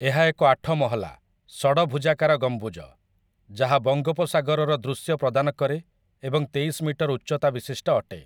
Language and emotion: Odia, neutral